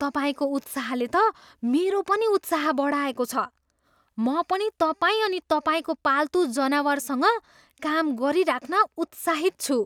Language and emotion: Nepali, surprised